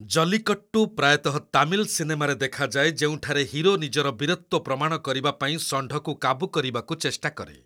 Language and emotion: Odia, neutral